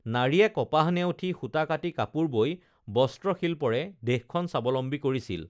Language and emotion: Assamese, neutral